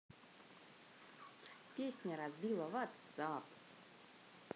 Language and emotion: Russian, positive